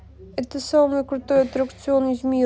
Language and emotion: Russian, sad